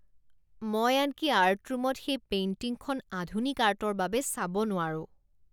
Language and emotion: Assamese, disgusted